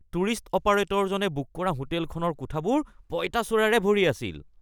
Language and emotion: Assamese, disgusted